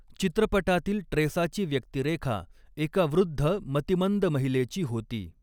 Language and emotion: Marathi, neutral